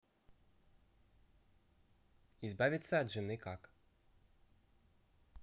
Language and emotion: Russian, neutral